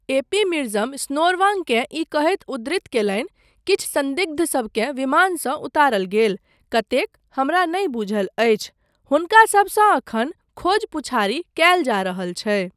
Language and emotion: Maithili, neutral